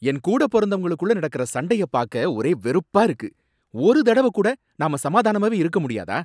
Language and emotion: Tamil, angry